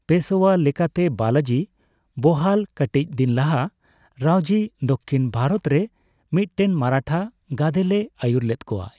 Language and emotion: Santali, neutral